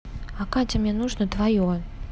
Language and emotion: Russian, neutral